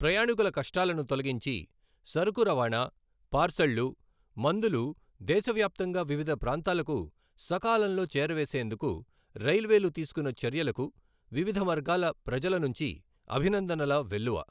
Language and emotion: Telugu, neutral